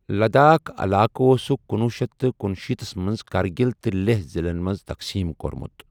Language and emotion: Kashmiri, neutral